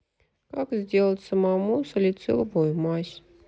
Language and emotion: Russian, sad